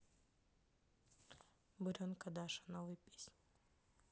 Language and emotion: Russian, neutral